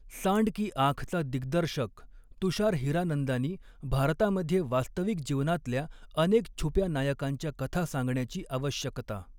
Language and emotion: Marathi, neutral